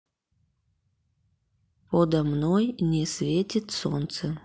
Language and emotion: Russian, neutral